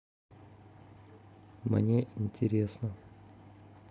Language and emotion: Russian, neutral